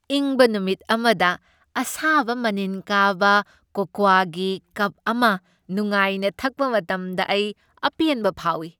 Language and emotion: Manipuri, happy